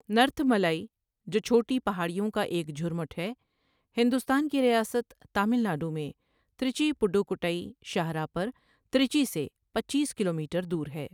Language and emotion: Urdu, neutral